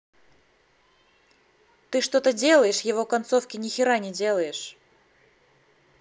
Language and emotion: Russian, angry